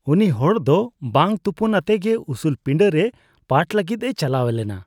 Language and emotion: Santali, disgusted